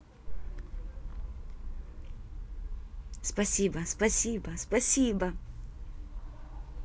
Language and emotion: Russian, positive